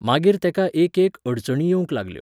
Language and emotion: Goan Konkani, neutral